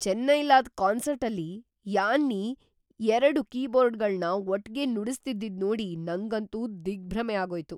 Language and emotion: Kannada, surprised